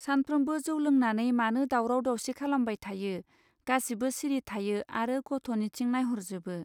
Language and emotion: Bodo, neutral